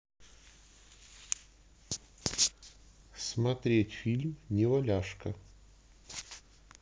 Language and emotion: Russian, neutral